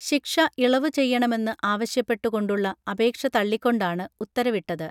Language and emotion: Malayalam, neutral